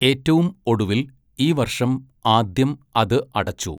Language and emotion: Malayalam, neutral